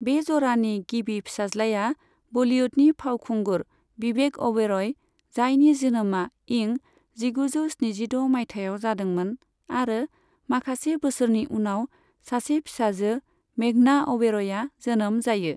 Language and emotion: Bodo, neutral